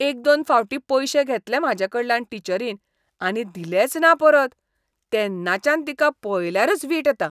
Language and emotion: Goan Konkani, disgusted